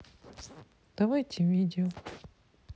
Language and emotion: Russian, sad